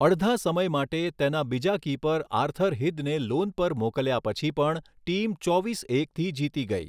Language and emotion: Gujarati, neutral